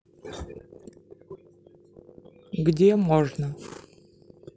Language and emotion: Russian, neutral